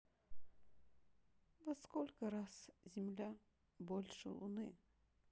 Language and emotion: Russian, sad